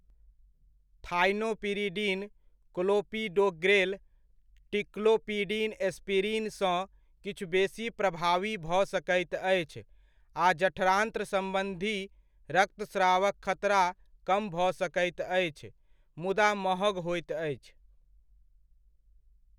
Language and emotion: Maithili, neutral